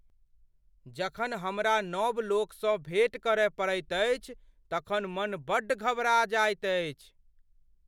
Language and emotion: Maithili, fearful